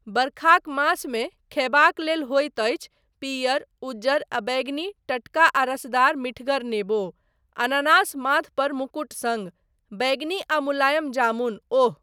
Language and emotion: Maithili, neutral